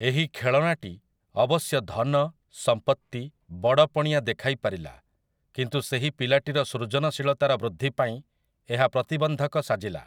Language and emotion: Odia, neutral